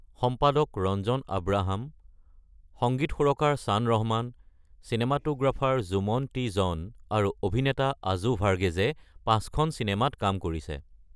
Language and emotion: Assamese, neutral